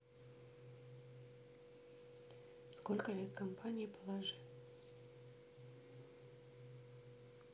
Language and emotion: Russian, neutral